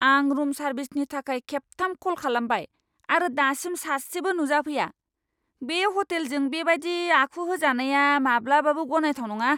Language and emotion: Bodo, angry